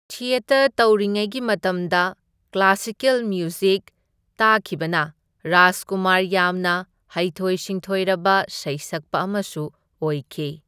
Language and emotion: Manipuri, neutral